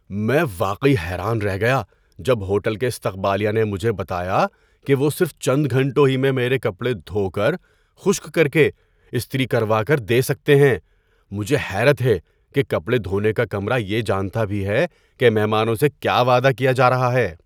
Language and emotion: Urdu, surprised